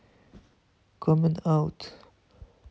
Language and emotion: Russian, neutral